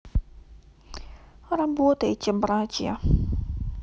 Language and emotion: Russian, sad